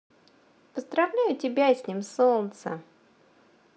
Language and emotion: Russian, positive